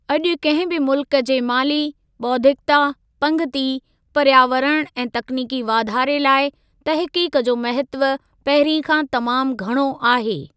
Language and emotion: Sindhi, neutral